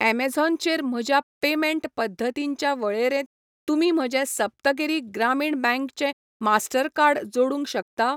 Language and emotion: Goan Konkani, neutral